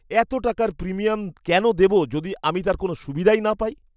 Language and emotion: Bengali, angry